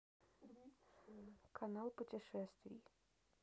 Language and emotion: Russian, neutral